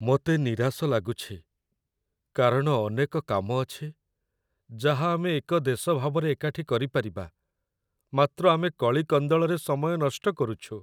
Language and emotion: Odia, sad